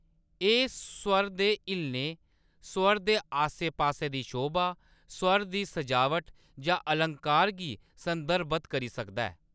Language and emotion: Dogri, neutral